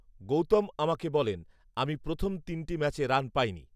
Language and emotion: Bengali, neutral